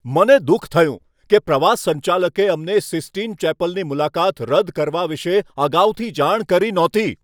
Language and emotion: Gujarati, angry